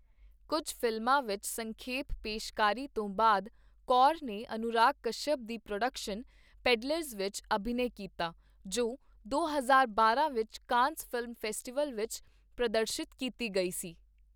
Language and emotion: Punjabi, neutral